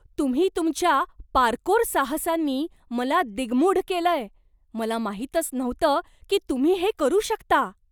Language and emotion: Marathi, surprised